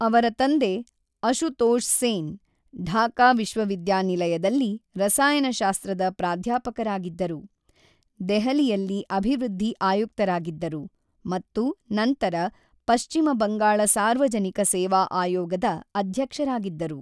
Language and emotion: Kannada, neutral